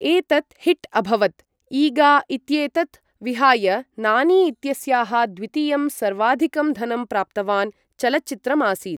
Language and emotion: Sanskrit, neutral